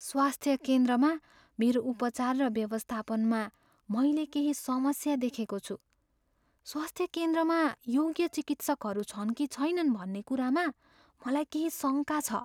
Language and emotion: Nepali, fearful